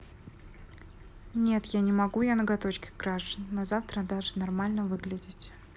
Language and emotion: Russian, neutral